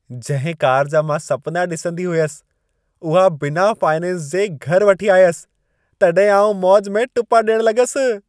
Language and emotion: Sindhi, happy